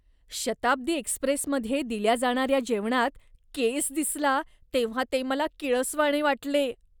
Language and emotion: Marathi, disgusted